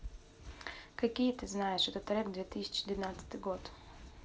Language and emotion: Russian, neutral